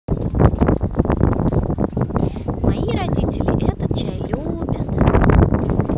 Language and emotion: Russian, positive